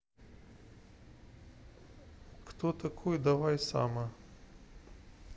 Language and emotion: Russian, neutral